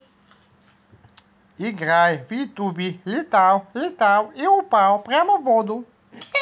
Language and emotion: Russian, positive